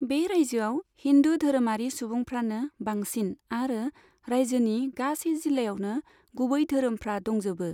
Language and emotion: Bodo, neutral